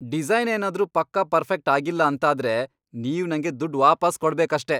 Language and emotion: Kannada, angry